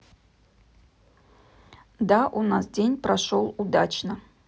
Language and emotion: Russian, neutral